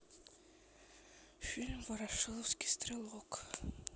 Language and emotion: Russian, sad